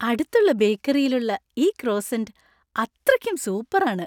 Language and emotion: Malayalam, happy